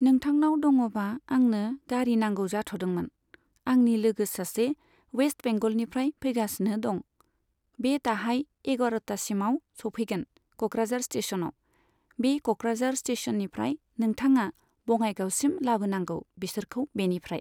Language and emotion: Bodo, neutral